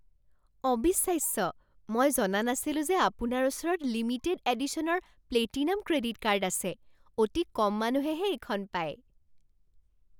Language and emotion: Assamese, surprised